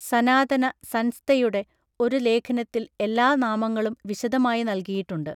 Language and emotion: Malayalam, neutral